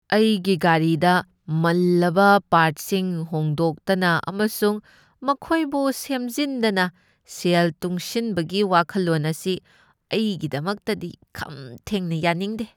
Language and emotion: Manipuri, disgusted